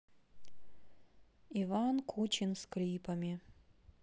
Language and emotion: Russian, neutral